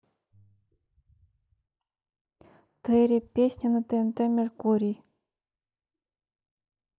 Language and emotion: Russian, neutral